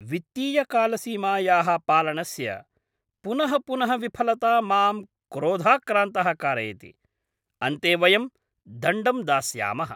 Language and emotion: Sanskrit, angry